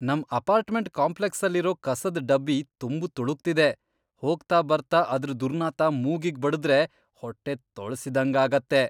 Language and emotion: Kannada, disgusted